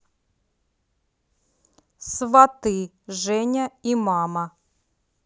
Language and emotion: Russian, neutral